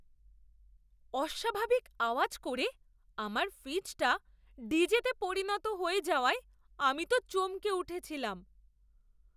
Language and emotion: Bengali, surprised